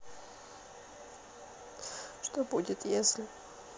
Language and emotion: Russian, sad